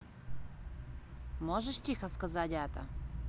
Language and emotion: Russian, neutral